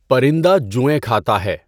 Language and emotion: Urdu, neutral